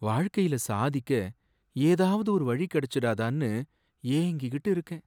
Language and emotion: Tamil, sad